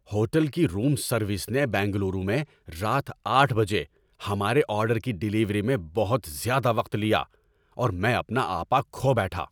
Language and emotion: Urdu, angry